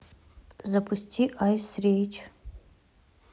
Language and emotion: Russian, neutral